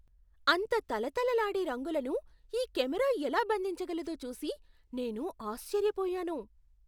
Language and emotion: Telugu, surprised